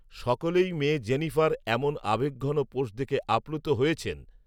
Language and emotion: Bengali, neutral